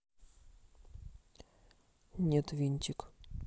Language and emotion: Russian, neutral